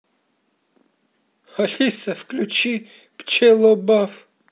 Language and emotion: Russian, neutral